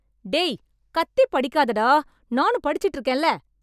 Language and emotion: Tamil, angry